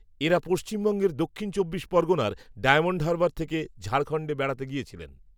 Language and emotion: Bengali, neutral